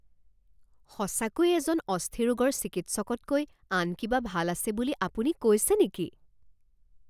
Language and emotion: Assamese, surprised